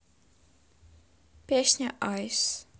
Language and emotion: Russian, neutral